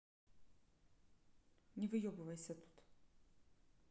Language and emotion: Russian, neutral